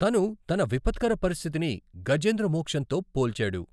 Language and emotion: Telugu, neutral